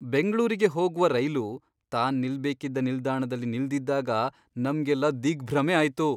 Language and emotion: Kannada, surprised